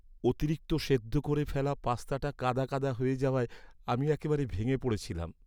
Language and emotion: Bengali, sad